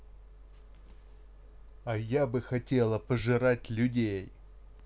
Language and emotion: Russian, angry